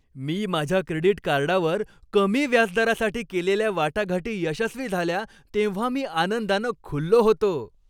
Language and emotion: Marathi, happy